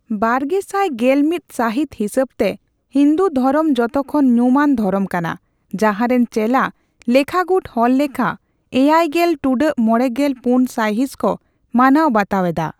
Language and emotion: Santali, neutral